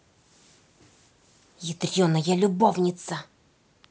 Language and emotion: Russian, angry